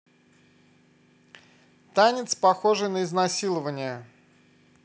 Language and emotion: Russian, neutral